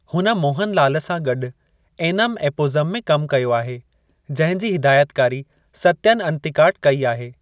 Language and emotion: Sindhi, neutral